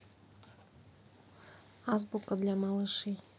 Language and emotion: Russian, neutral